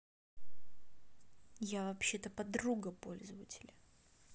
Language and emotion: Russian, angry